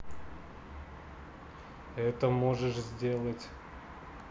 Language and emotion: Russian, neutral